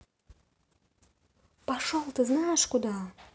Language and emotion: Russian, angry